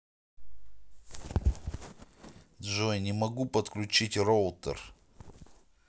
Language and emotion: Russian, neutral